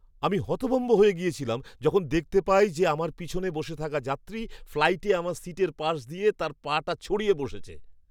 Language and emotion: Bengali, surprised